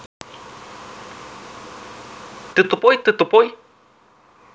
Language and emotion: Russian, neutral